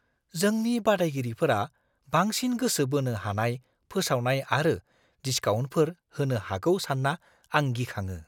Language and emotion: Bodo, fearful